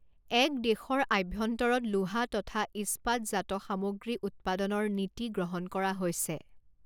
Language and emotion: Assamese, neutral